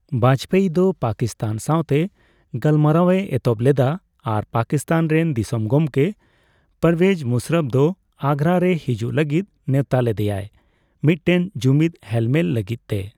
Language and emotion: Santali, neutral